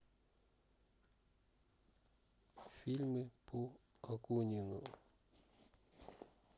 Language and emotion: Russian, neutral